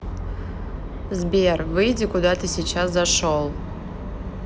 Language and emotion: Russian, neutral